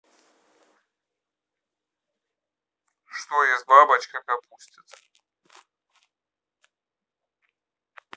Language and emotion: Russian, neutral